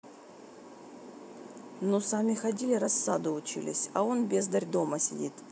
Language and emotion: Russian, neutral